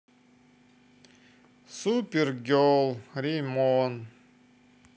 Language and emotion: Russian, positive